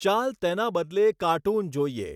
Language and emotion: Gujarati, neutral